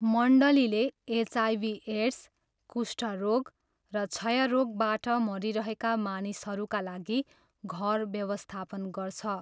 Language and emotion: Nepali, neutral